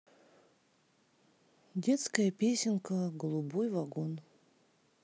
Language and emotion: Russian, neutral